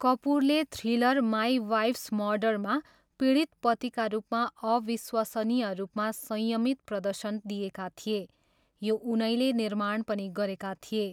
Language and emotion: Nepali, neutral